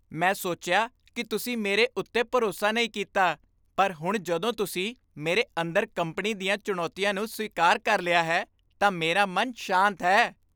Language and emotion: Punjabi, happy